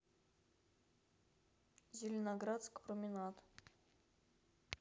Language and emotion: Russian, neutral